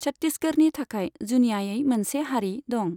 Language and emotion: Bodo, neutral